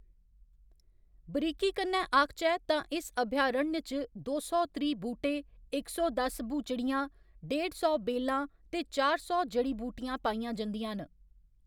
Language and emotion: Dogri, neutral